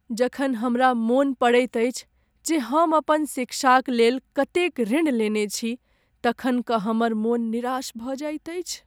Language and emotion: Maithili, sad